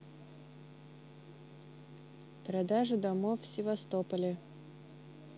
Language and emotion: Russian, neutral